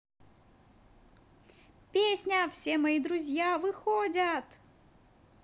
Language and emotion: Russian, positive